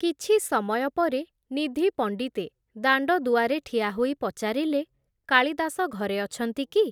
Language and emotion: Odia, neutral